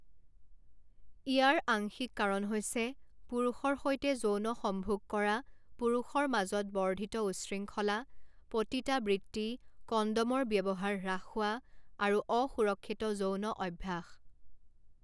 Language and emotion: Assamese, neutral